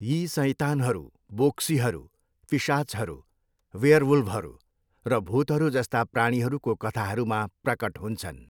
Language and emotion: Nepali, neutral